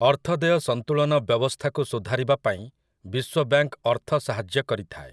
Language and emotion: Odia, neutral